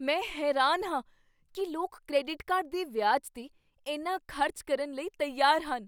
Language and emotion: Punjabi, surprised